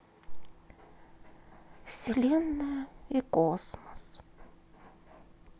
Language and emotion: Russian, sad